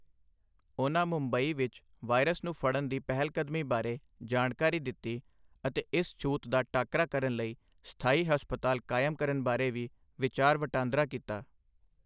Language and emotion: Punjabi, neutral